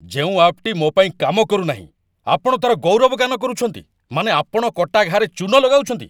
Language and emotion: Odia, angry